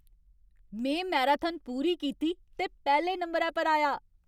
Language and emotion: Dogri, happy